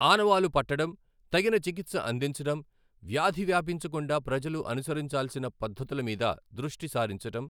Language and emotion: Telugu, neutral